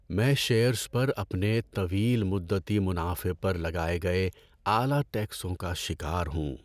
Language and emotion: Urdu, sad